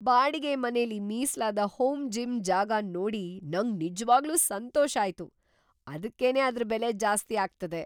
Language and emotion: Kannada, surprised